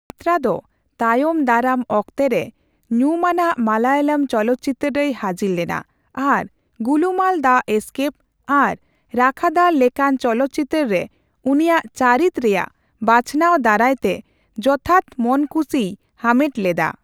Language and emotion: Santali, neutral